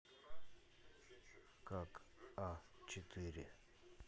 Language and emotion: Russian, neutral